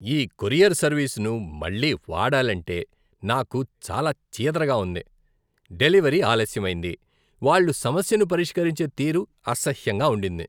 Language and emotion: Telugu, disgusted